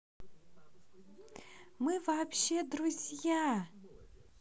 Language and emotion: Russian, positive